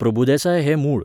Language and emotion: Goan Konkani, neutral